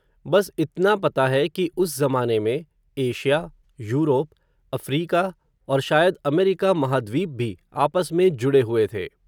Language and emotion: Hindi, neutral